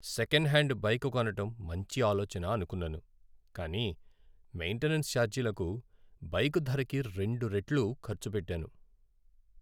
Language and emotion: Telugu, sad